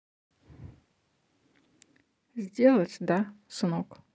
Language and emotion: Russian, neutral